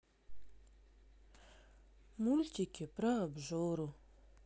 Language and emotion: Russian, sad